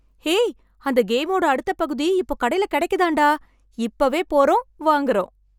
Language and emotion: Tamil, happy